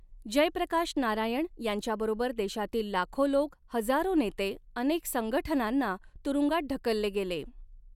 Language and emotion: Marathi, neutral